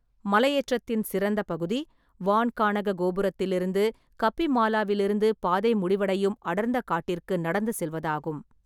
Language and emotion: Tamil, neutral